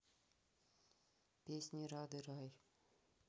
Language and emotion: Russian, neutral